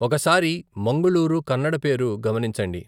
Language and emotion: Telugu, neutral